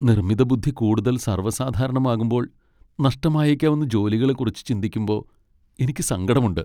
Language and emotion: Malayalam, sad